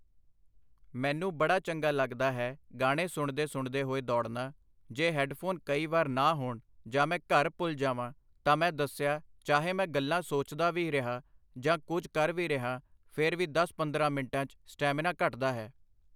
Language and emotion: Punjabi, neutral